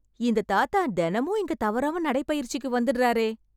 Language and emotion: Tamil, surprised